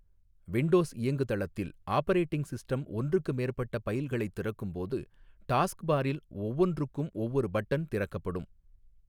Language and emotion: Tamil, neutral